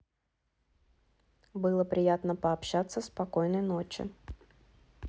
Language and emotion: Russian, neutral